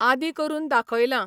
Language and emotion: Goan Konkani, neutral